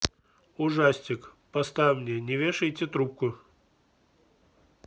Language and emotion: Russian, neutral